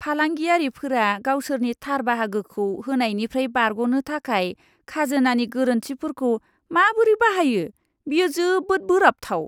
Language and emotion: Bodo, disgusted